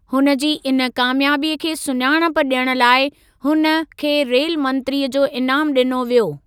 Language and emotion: Sindhi, neutral